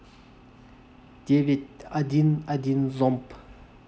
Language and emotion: Russian, neutral